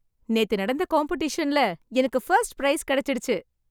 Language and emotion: Tamil, happy